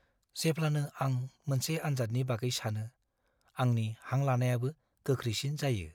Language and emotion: Bodo, fearful